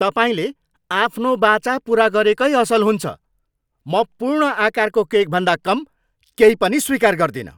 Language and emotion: Nepali, angry